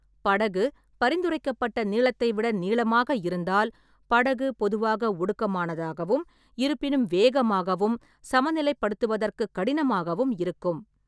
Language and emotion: Tamil, neutral